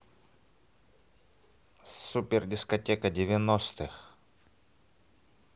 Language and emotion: Russian, positive